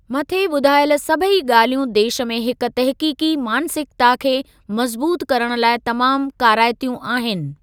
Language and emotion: Sindhi, neutral